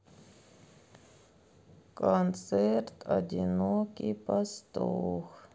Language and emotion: Russian, sad